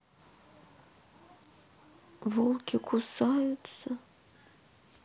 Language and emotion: Russian, sad